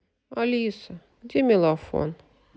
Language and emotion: Russian, sad